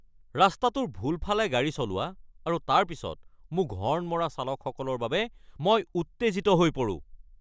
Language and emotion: Assamese, angry